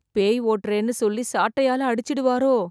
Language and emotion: Tamil, fearful